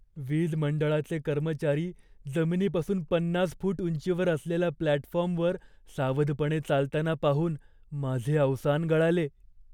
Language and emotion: Marathi, fearful